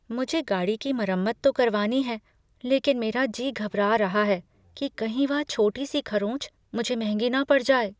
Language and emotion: Hindi, fearful